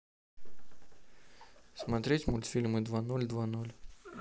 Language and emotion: Russian, neutral